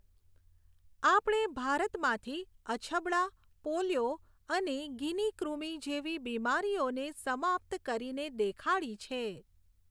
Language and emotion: Gujarati, neutral